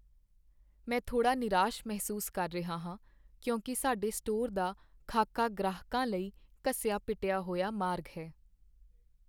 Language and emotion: Punjabi, sad